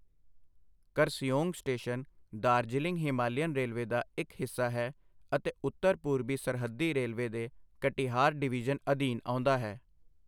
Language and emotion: Punjabi, neutral